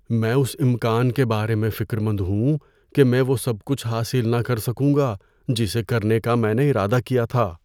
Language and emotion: Urdu, fearful